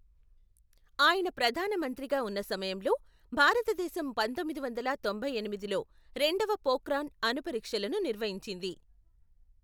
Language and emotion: Telugu, neutral